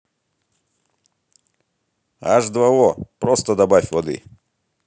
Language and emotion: Russian, positive